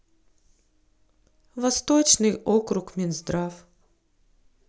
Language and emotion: Russian, sad